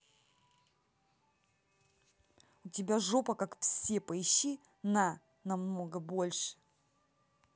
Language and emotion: Russian, angry